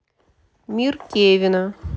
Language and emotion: Russian, neutral